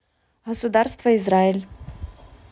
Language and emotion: Russian, neutral